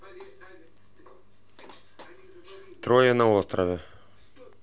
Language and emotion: Russian, neutral